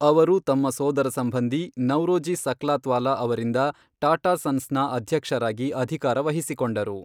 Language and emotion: Kannada, neutral